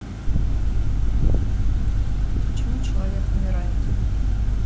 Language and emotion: Russian, sad